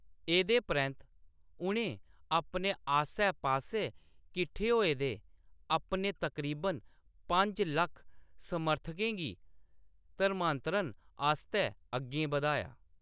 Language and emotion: Dogri, neutral